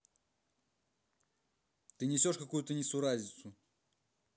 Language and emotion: Russian, angry